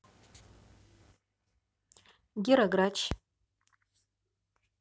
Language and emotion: Russian, neutral